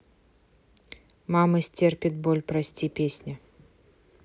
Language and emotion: Russian, neutral